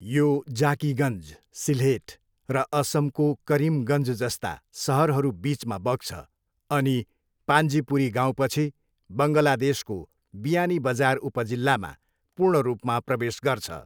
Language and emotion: Nepali, neutral